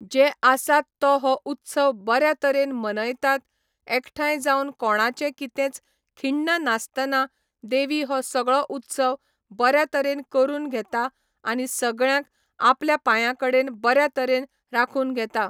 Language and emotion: Goan Konkani, neutral